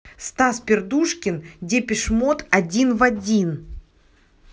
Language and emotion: Russian, neutral